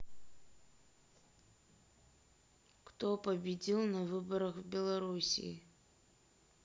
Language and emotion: Russian, neutral